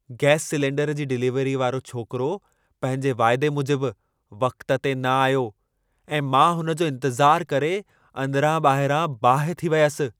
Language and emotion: Sindhi, angry